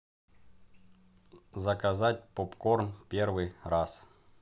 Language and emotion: Russian, neutral